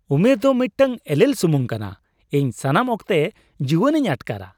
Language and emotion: Santali, happy